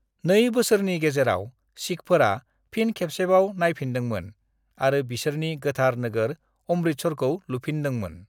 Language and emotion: Bodo, neutral